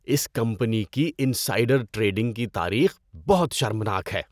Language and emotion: Urdu, disgusted